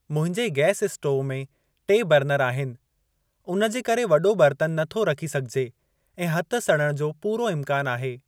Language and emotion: Sindhi, neutral